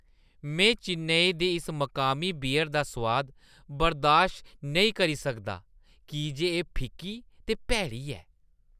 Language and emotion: Dogri, disgusted